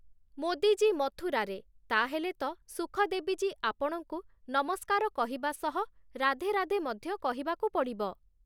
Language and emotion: Odia, neutral